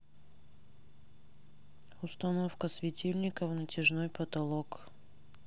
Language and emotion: Russian, neutral